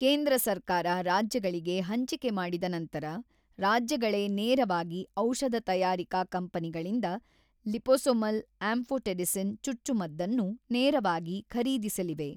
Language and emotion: Kannada, neutral